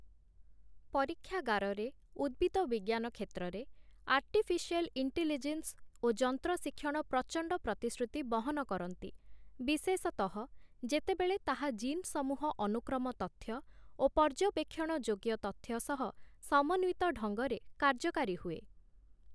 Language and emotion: Odia, neutral